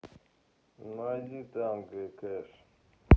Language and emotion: Russian, neutral